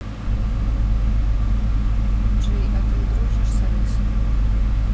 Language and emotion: Russian, neutral